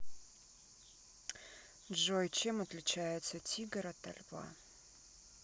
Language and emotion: Russian, sad